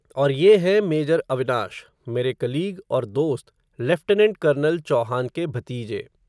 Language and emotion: Hindi, neutral